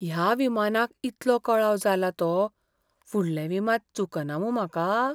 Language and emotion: Goan Konkani, fearful